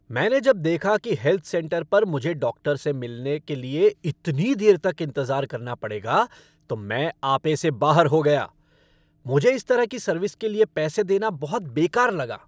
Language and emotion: Hindi, angry